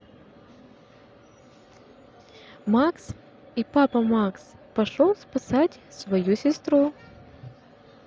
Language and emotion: Russian, neutral